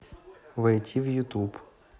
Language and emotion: Russian, neutral